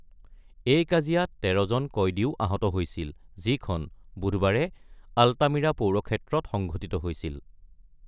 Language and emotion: Assamese, neutral